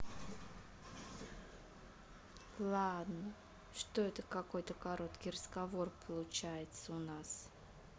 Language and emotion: Russian, neutral